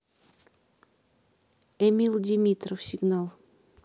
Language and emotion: Russian, neutral